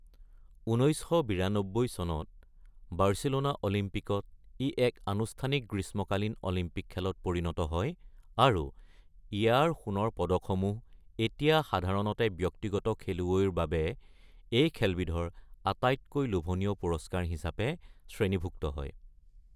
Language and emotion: Assamese, neutral